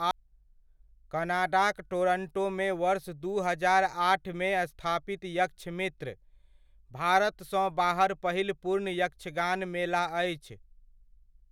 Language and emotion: Maithili, neutral